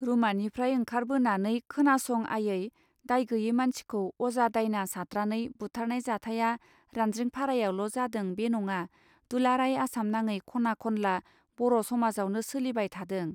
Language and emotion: Bodo, neutral